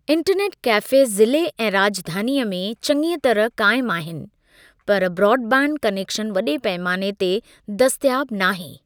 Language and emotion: Sindhi, neutral